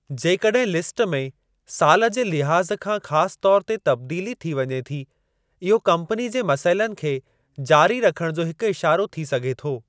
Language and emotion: Sindhi, neutral